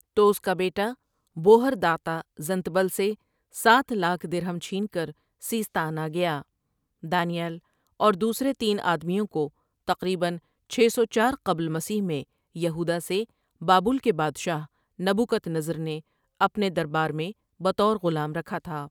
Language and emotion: Urdu, neutral